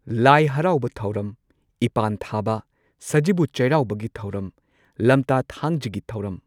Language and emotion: Manipuri, neutral